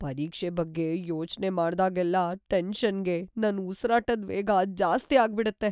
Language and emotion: Kannada, fearful